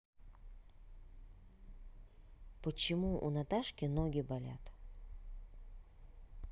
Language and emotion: Russian, neutral